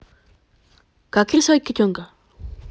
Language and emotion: Russian, positive